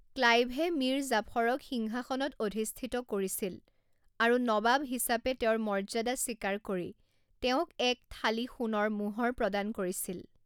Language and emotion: Assamese, neutral